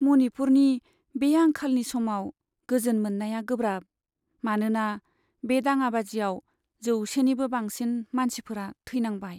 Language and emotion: Bodo, sad